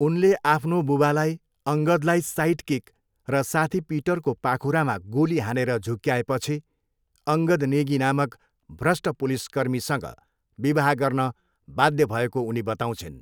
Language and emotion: Nepali, neutral